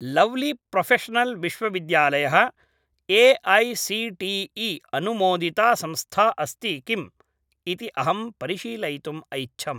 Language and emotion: Sanskrit, neutral